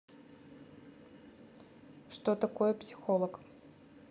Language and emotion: Russian, neutral